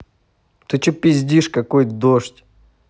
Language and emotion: Russian, angry